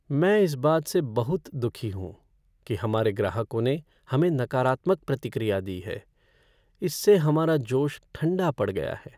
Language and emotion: Hindi, sad